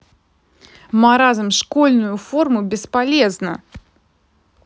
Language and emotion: Russian, angry